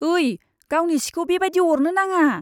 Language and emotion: Bodo, disgusted